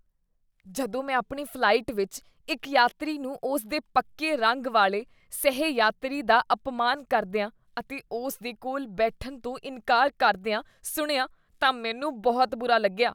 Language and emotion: Punjabi, disgusted